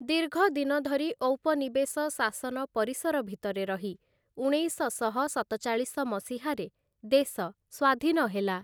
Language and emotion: Odia, neutral